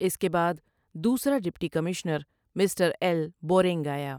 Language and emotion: Urdu, neutral